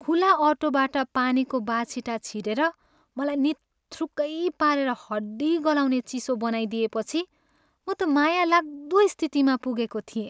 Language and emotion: Nepali, sad